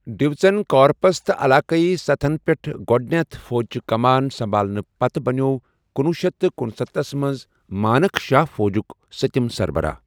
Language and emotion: Kashmiri, neutral